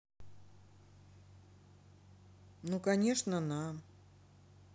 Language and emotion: Russian, neutral